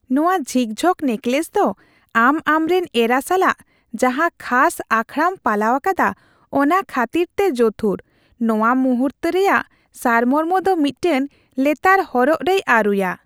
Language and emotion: Santali, happy